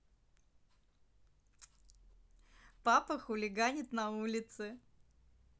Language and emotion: Russian, positive